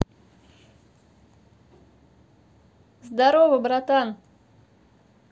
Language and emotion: Russian, positive